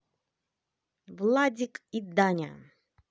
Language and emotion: Russian, positive